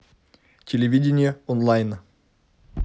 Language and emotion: Russian, neutral